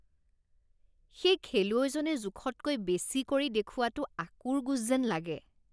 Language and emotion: Assamese, disgusted